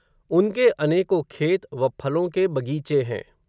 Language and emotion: Hindi, neutral